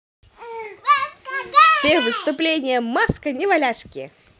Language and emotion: Russian, positive